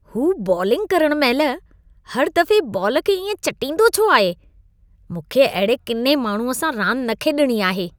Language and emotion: Sindhi, disgusted